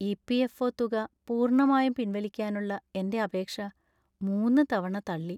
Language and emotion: Malayalam, sad